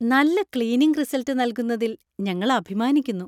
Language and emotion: Malayalam, happy